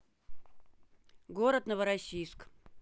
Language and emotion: Russian, neutral